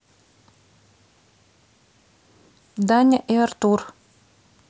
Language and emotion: Russian, neutral